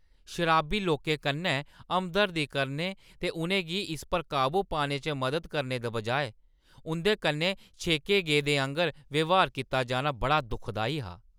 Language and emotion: Dogri, angry